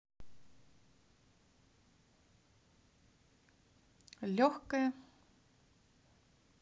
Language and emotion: Russian, positive